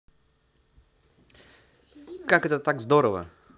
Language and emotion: Russian, positive